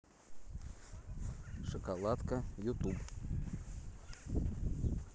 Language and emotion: Russian, neutral